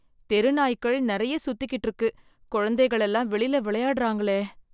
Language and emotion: Tamil, fearful